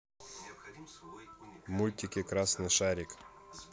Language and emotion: Russian, neutral